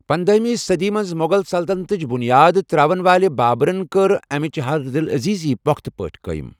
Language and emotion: Kashmiri, neutral